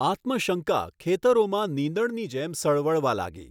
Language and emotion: Gujarati, neutral